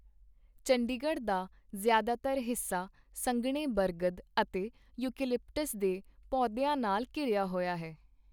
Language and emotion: Punjabi, neutral